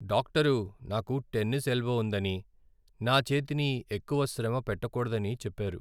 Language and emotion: Telugu, sad